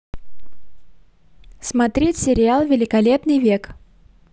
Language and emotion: Russian, positive